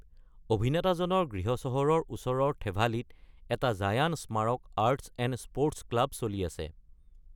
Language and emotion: Assamese, neutral